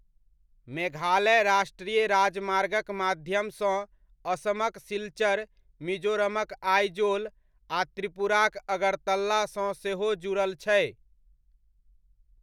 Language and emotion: Maithili, neutral